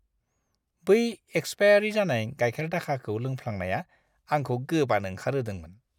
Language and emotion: Bodo, disgusted